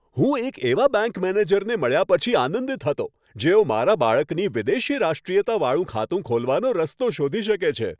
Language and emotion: Gujarati, happy